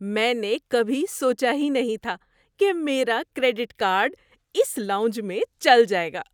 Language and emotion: Urdu, surprised